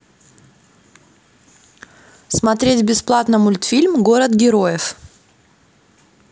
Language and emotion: Russian, neutral